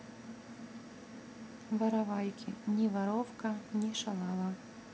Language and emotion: Russian, neutral